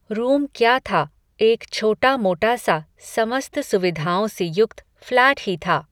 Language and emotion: Hindi, neutral